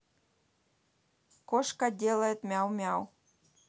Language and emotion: Russian, neutral